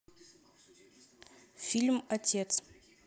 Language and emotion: Russian, neutral